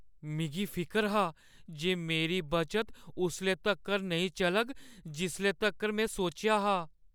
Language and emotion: Dogri, fearful